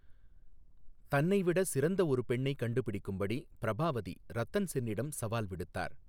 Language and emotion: Tamil, neutral